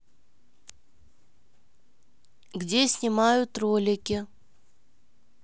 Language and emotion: Russian, neutral